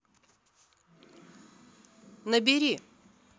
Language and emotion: Russian, neutral